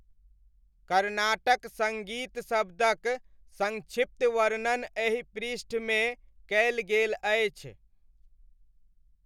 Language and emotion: Maithili, neutral